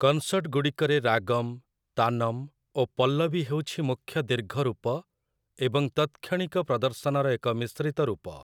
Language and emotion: Odia, neutral